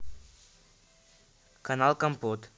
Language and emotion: Russian, neutral